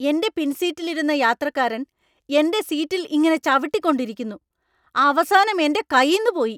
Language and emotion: Malayalam, angry